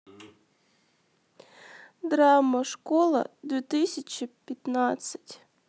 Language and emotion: Russian, sad